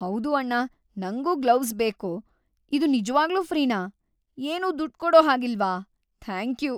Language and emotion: Kannada, happy